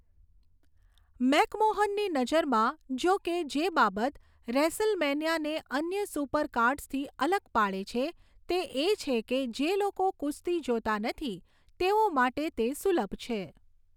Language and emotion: Gujarati, neutral